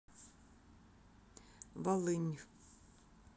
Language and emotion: Russian, neutral